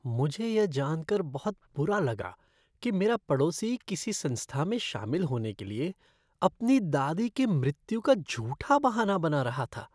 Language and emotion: Hindi, disgusted